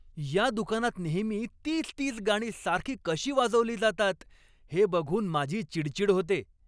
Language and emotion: Marathi, angry